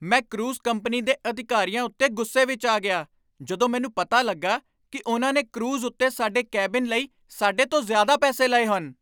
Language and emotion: Punjabi, angry